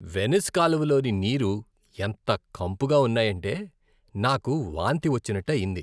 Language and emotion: Telugu, disgusted